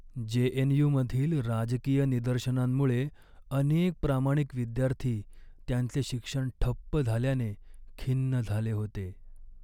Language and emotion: Marathi, sad